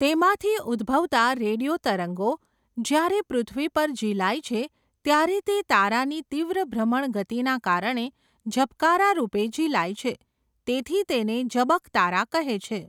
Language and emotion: Gujarati, neutral